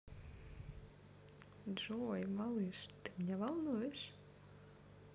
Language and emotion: Russian, positive